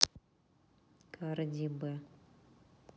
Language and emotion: Russian, neutral